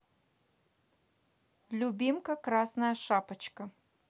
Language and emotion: Russian, neutral